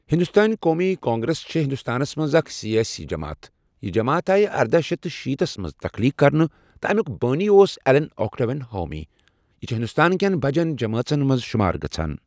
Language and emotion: Kashmiri, neutral